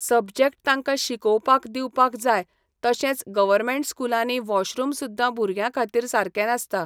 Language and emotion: Goan Konkani, neutral